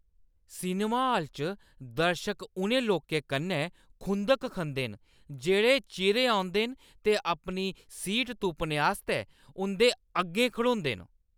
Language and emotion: Dogri, angry